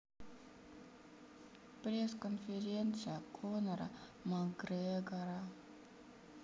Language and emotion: Russian, sad